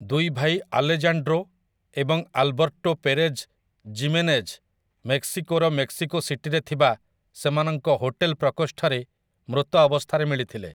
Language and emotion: Odia, neutral